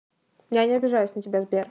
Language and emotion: Russian, neutral